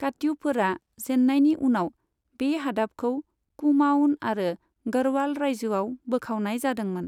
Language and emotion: Bodo, neutral